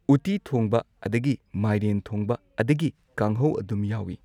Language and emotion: Manipuri, neutral